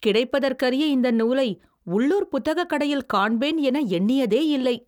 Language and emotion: Tamil, surprised